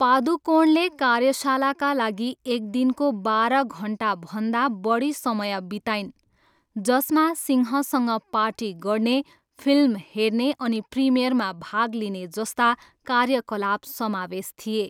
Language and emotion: Nepali, neutral